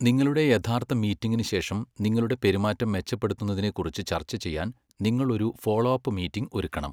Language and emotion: Malayalam, neutral